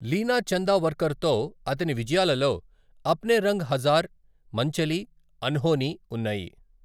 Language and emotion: Telugu, neutral